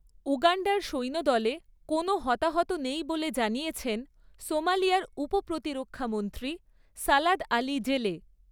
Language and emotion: Bengali, neutral